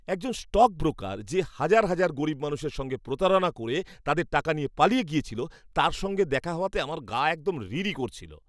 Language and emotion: Bengali, disgusted